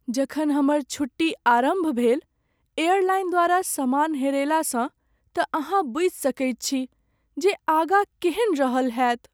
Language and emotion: Maithili, sad